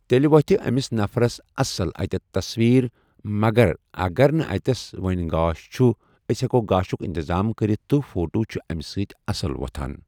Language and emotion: Kashmiri, neutral